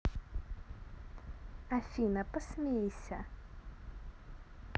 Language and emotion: Russian, neutral